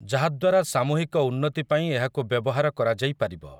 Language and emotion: Odia, neutral